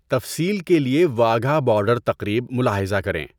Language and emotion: Urdu, neutral